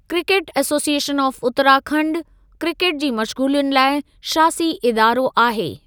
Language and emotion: Sindhi, neutral